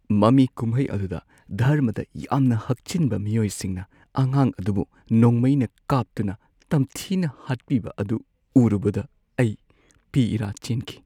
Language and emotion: Manipuri, sad